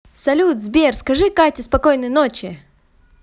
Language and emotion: Russian, positive